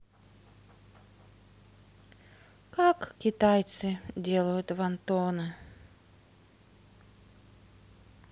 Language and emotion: Russian, sad